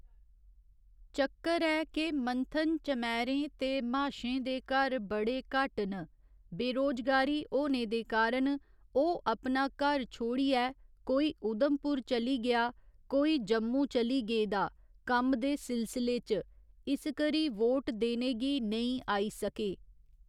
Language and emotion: Dogri, neutral